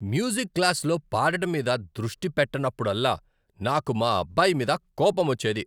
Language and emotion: Telugu, angry